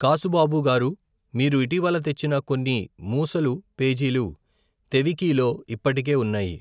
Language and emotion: Telugu, neutral